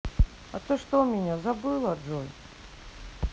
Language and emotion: Russian, sad